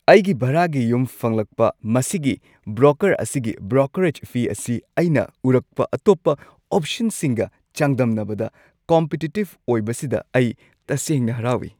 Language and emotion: Manipuri, happy